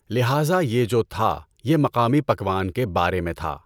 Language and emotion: Urdu, neutral